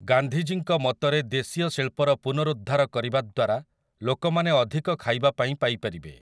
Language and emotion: Odia, neutral